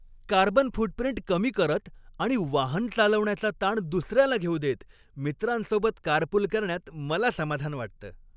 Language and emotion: Marathi, happy